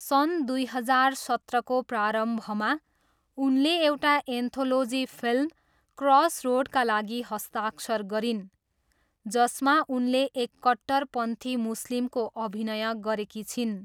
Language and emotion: Nepali, neutral